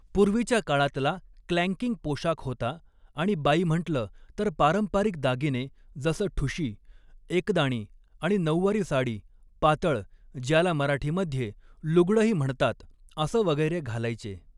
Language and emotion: Marathi, neutral